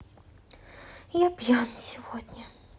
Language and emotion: Russian, sad